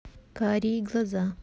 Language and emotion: Russian, neutral